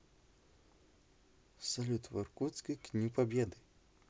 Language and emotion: Russian, neutral